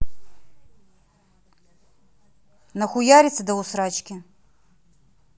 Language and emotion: Russian, angry